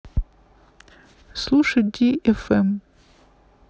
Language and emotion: Russian, neutral